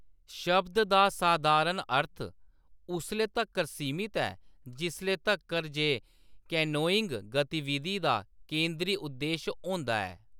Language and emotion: Dogri, neutral